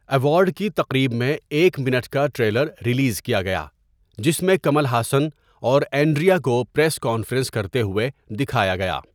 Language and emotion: Urdu, neutral